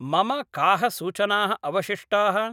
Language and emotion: Sanskrit, neutral